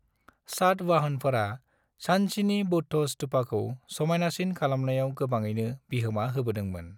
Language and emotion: Bodo, neutral